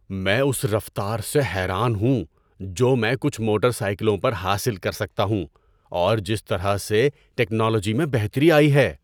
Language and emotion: Urdu, surprised